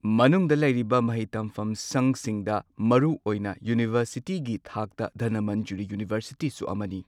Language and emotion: Manipuri, neutral